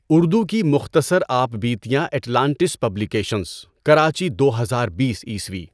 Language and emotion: Urdu, neutral